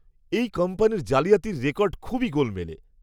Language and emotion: Bengali, disgusted